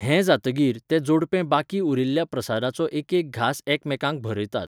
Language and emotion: Goan Konkani, neutral